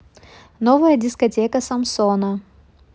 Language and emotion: Russian, neutral